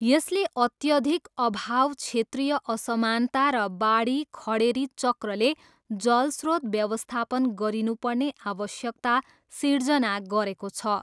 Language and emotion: Nepali, neutral